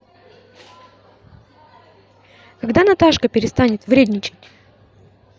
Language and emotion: Russian, positive